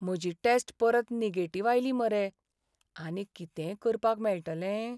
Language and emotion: Goan Konkani, sad